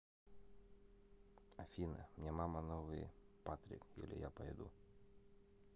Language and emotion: Russian, neutral